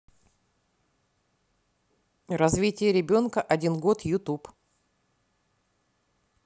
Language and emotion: Russian, neutral